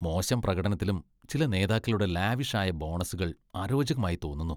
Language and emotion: Malayalam, disgusted